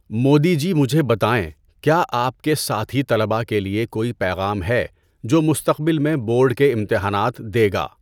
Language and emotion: Urdu, neutral